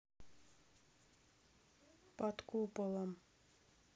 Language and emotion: Russian, neutral